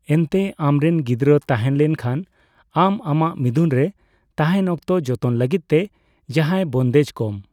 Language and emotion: Santali, neutral